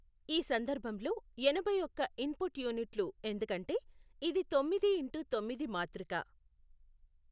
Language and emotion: Telugu, neutral